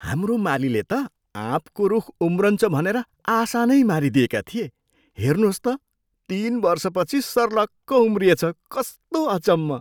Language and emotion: Nepali, surprised